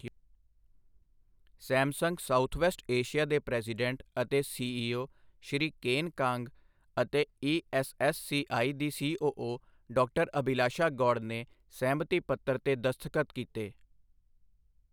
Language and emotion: Punjabi, neutral